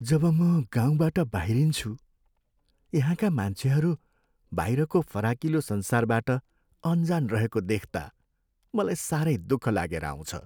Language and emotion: Nepali, sad